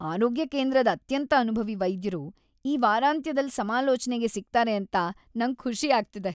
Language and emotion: Kannada, happy